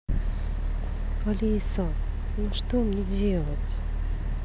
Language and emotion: Russian, sad